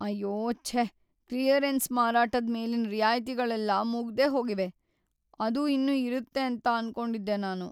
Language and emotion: Kannada, sad